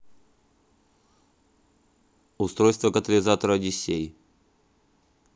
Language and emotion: Russian, neutral